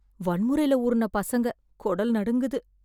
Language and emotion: Tamil, fearful